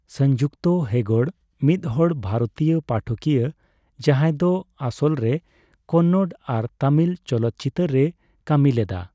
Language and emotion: Santali, neutral